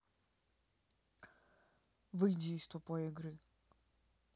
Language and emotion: Russian, neutral